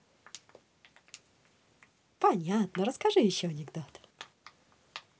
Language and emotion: Russian, positive